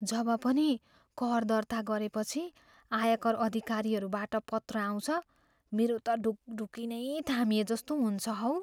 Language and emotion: Nepali, fearful